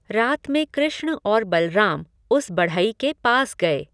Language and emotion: Hindi, neutral